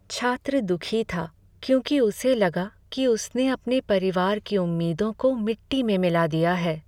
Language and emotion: Hindi, sad